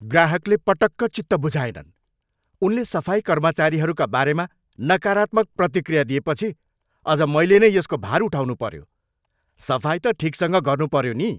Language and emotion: Nepali, angry